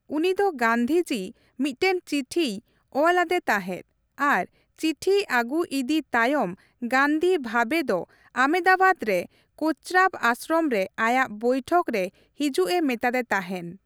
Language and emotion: Santali, neutral